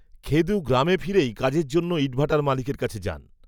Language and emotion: Bengali, neutral